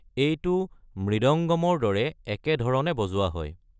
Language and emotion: Assamese, neutral